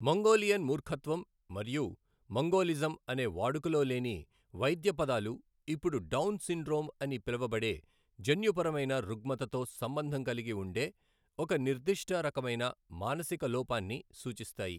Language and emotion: Telugu, neutral